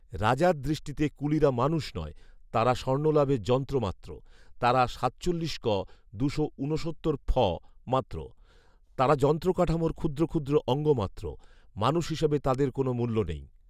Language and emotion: Bengali, neutral